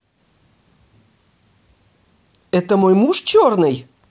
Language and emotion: Russian, angry